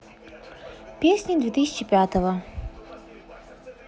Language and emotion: Russian, neutral